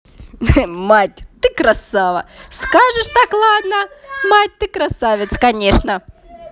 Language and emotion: Russian, positive